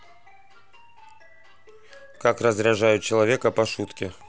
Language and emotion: Russian, neutral